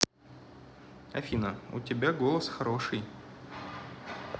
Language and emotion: Russian, neutral